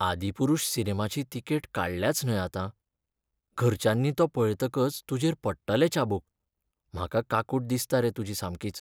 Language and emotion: Goan Konkani, sad